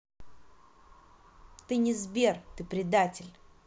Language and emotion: Russian, angry